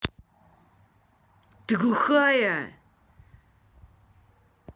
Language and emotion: Russian, angry